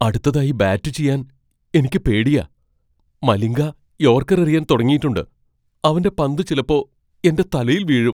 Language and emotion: Malayalam, fearful